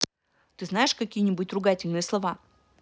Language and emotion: Russian, neutral